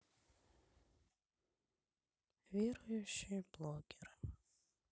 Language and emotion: Russian, sad